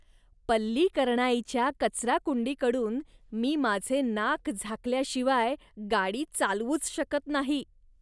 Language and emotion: Marathi, disgusted